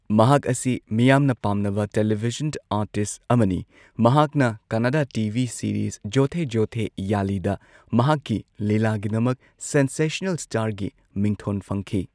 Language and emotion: Manipuri, neutral